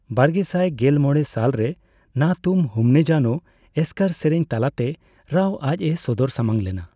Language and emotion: Santali, neutral